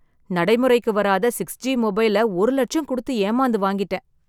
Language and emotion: Tamil, sad